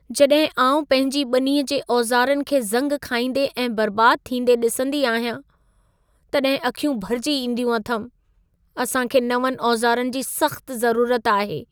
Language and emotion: Sindhi, sad